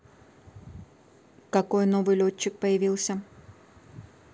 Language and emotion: Russian, neutral